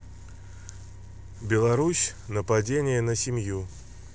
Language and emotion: Russian, neutral